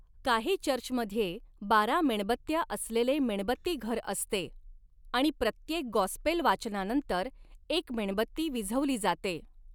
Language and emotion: Marathi, neutral